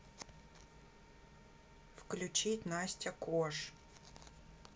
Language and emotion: Russian, neutral